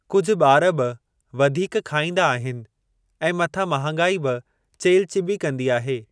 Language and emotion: Sindhi, neutral